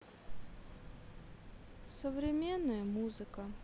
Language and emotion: Russian, sad